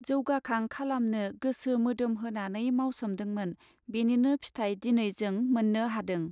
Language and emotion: Bodo, neutral